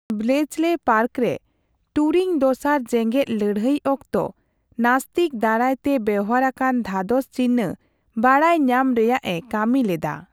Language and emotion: Santali, neutral